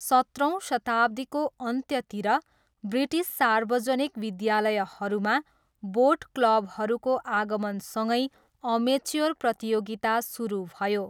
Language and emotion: Nepali, neutral